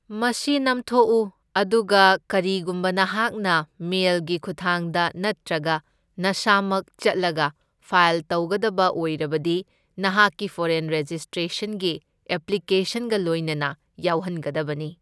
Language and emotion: Manipuri, neutral